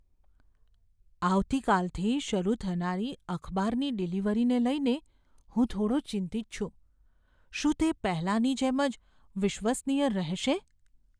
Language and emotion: Gujarati, fearful